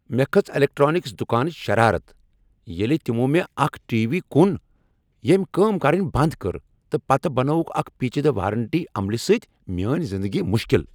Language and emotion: Kashmiri, angry